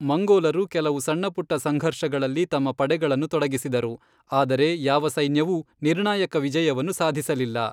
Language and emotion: Kannada, neutral